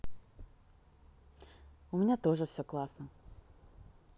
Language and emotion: Russian, positive